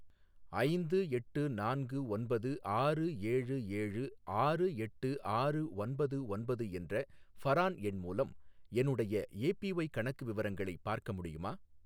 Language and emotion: Tamil, neutral